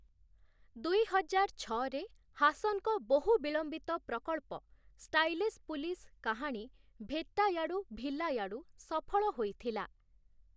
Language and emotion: Odia, neutral